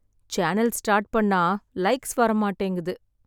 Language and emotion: Tamil, sad